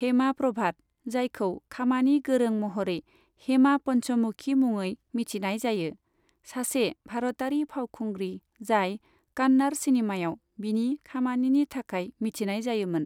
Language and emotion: Bodo, neutral